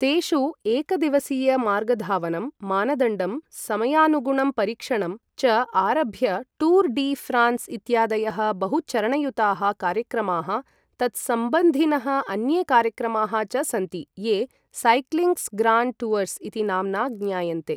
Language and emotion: Sanskrit, neutral